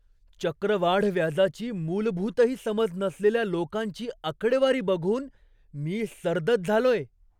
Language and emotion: Marathi, surprised